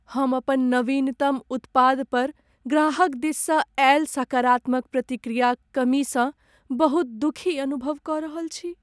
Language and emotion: Maithili, sad